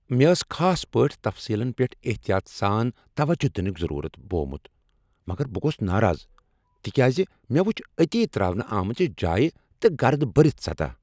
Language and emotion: Kashmiri, angry